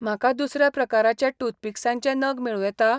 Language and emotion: Goan Konkani, neutral